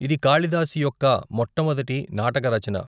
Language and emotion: Telugu, neutral